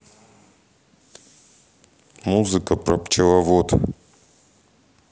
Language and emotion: Russian, neutral